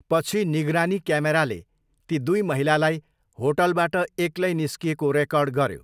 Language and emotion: Nepali, neutral